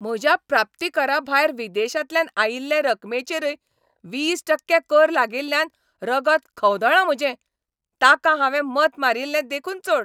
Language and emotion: Goan Konkani, angry